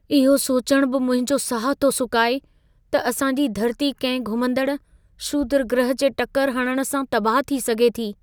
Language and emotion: Sindhi, fearful